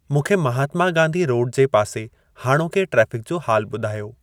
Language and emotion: Sindhi, neutral